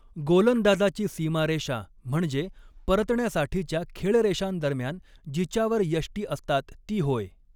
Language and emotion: Marathi, neutral